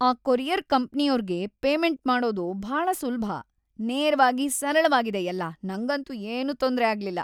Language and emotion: Kannada, happy